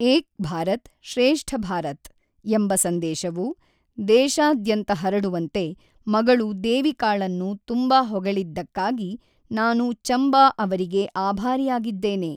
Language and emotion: Kannada, neutral